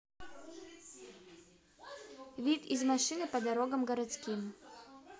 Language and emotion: Russian, neutral